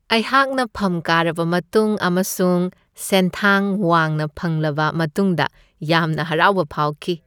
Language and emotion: Manipuri, happy